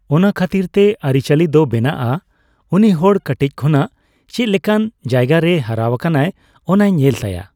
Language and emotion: Santali, neutral